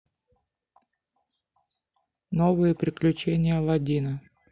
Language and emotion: Russian, neutral